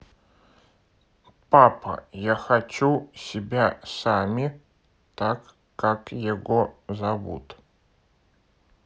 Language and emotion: Russian, neutral